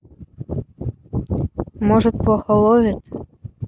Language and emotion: Russian, neutral